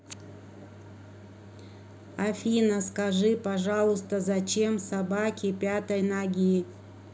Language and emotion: Russian, neutral